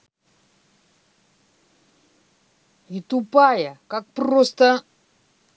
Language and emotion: Russian, angry